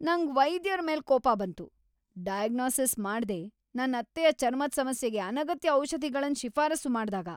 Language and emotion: Kannada, angry